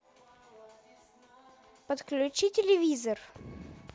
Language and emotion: Russian, neutral